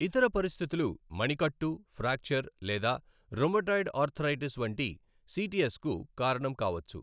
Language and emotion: Telugu, neutral